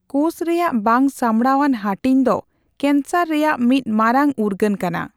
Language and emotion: Santali, neutral